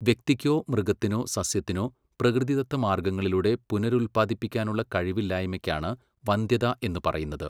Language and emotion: Malayalam, neutral